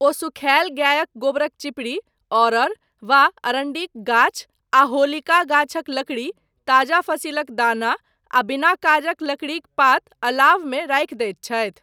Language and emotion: Maithili, neutral